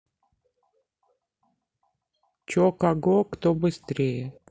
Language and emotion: Russian, neutral